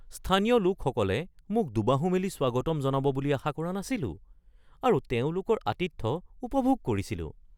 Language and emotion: Assamese, surprised